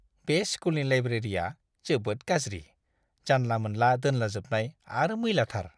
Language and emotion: Bodo, disgusted